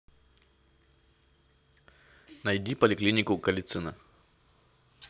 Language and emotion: Russian, neutral